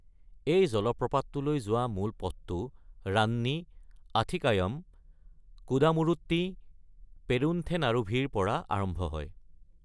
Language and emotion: Assamese, neutral